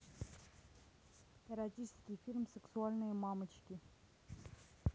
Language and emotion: Russian, neutral